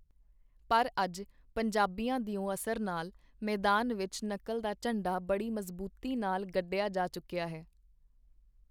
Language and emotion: Punjabi, neutral